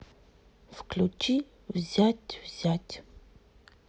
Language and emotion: Russian, sad